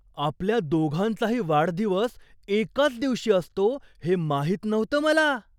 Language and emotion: Marathi, surprised